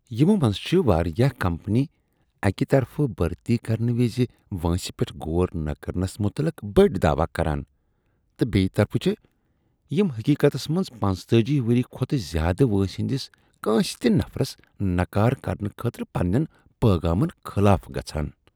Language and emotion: Kashmiri, disgusted